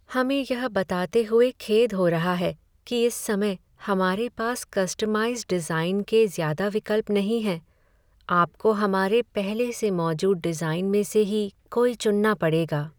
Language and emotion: Hindi, sad